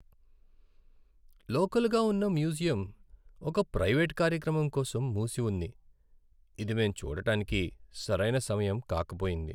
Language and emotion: Telugu, sad